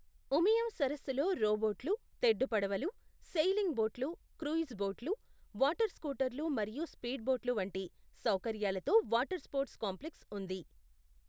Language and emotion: Telugu, neutral